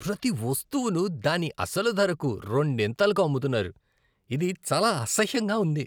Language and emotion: Telugu, disgusted